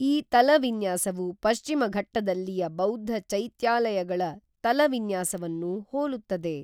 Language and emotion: Kannada, neutral